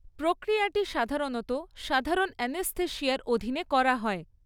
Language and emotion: Bengali, neutral